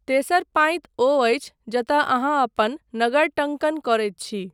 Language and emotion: Maithili, neutral